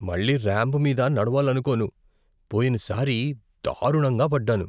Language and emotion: Telugu, fearful